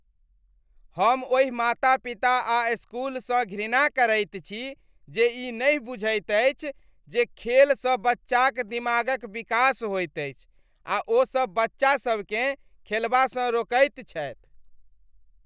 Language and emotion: Maithili, disgusted